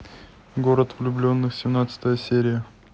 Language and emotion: Russian, neutral